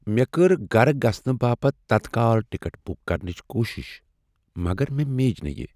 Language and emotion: Kashmiri, sad